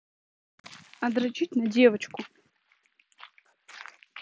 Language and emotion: Russian, neutral